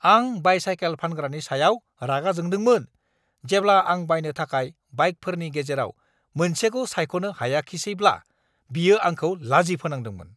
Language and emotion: Bodo, angry